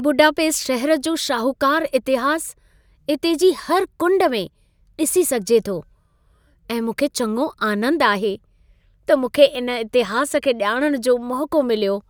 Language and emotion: Sindhi, happy